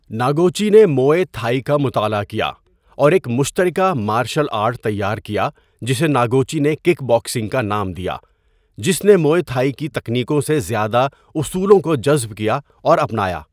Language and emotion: Urdu, neutral